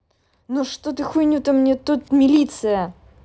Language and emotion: Russian, angry